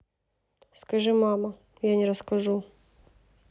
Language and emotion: Russian, neutral